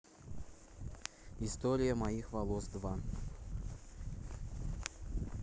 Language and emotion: Russian, neutral